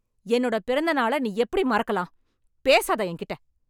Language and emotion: Tamil, angry